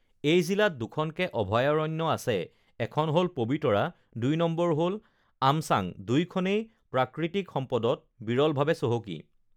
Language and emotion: Assamese, neutral